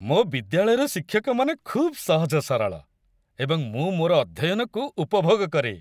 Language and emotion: Odia, happy